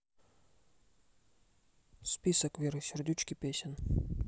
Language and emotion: Russian, neutral